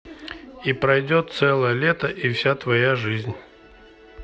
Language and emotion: Russian, neutral